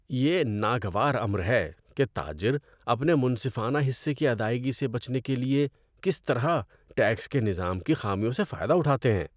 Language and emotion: Urdu, disgusted